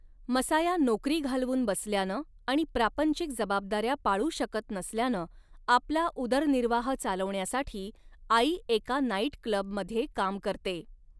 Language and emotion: Marathi, neutral